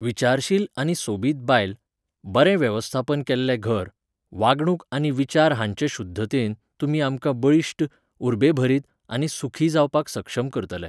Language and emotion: Goan Konkani, neutral